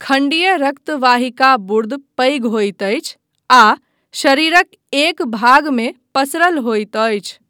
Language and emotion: Maithili, neutral